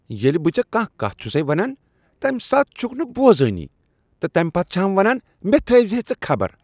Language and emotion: Kashmiri, disgusted